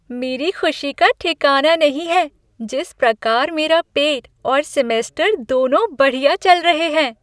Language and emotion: Hindi, happy